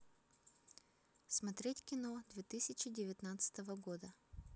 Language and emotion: Russian, neutral